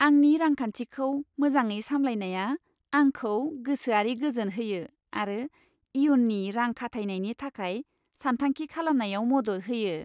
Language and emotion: Bodo, happy